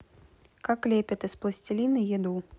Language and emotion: Russian, neutral